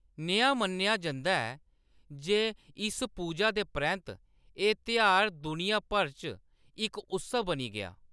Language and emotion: Dogri, neutral